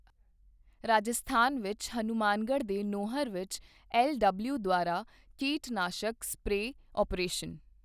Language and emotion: Punjabi, neutral